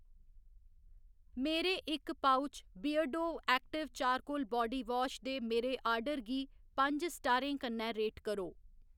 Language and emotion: Dogri, neutral